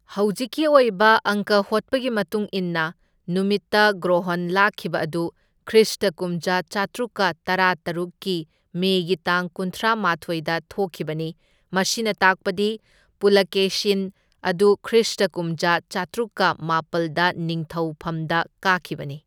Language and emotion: Manipuri, neutral